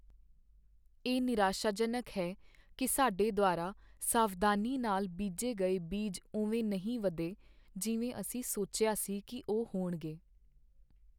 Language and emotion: Punjabi, sad